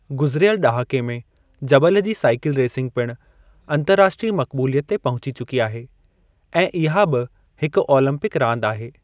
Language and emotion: Sindhi, neutral